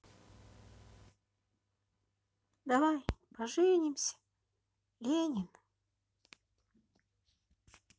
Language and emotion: Russian, neutral